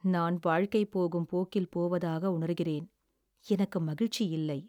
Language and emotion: Tamil, sad